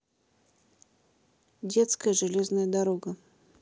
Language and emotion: Russian, neutral